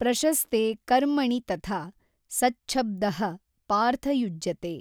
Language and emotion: Kannada, neutral